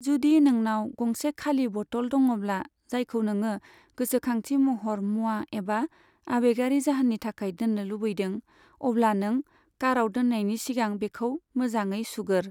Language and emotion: Bodo, neutral